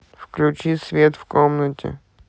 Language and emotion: Russian, neutral